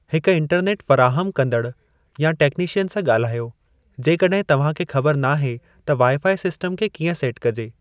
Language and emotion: Sindhi, neutral